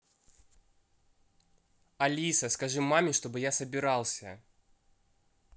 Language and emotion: Russian, neutral